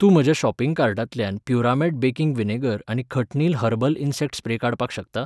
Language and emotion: Goan Konkani, neutral